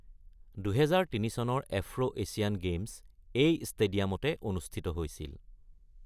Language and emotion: Assamese, neutral